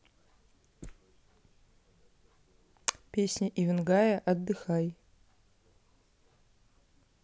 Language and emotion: Russian, neutral